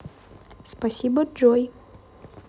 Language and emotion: Russian, neutral